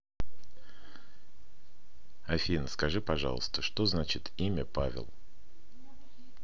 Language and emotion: Russian, neutral